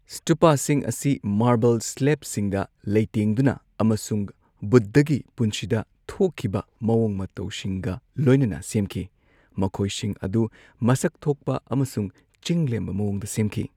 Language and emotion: Manipuri, neutral